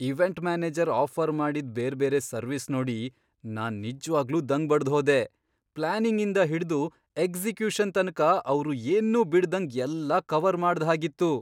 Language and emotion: Kannada, surprised